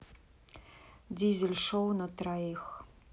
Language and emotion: Russian, neutral